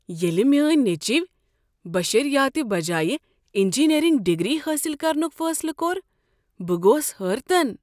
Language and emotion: Kashmiri, surprised